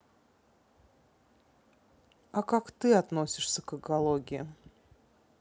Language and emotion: Russian, neutral